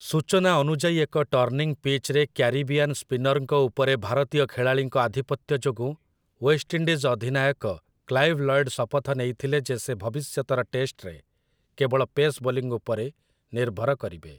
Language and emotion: Odia, neutral